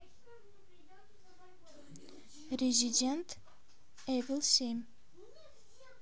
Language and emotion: Russian, neutral